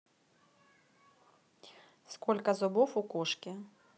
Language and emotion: Russian, neutral